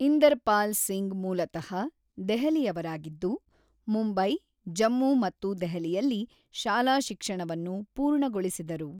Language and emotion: Kannada, neutral